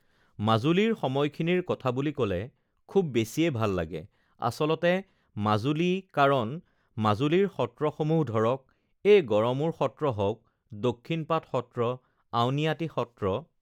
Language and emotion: Assamese, neutral